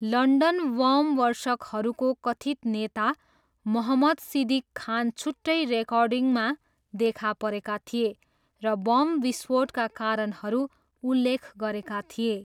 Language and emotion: Nepali, neutral